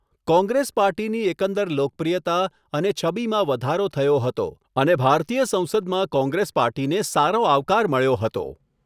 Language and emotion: Gujarati, neutral